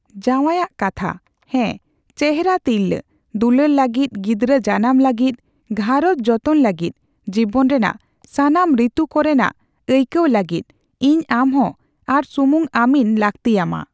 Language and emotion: Santali, neutral